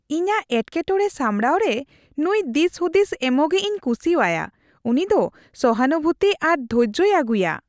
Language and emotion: Santali, happy